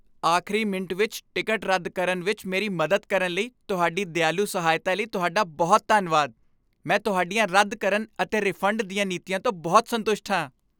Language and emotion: Punjabi, happy